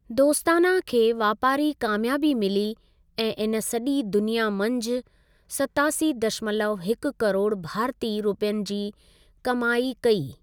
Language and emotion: Sindhi, neutral